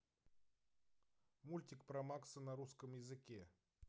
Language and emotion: Russian, neutral